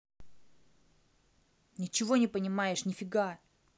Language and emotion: Russian, angry